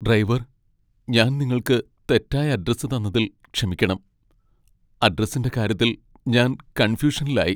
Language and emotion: Malayalam, sad